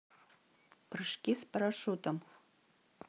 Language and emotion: Russian, neutral